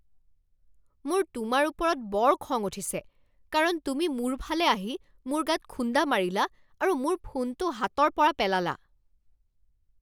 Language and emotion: Assamese, angry